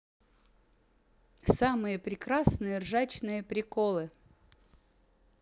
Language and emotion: Russian, positive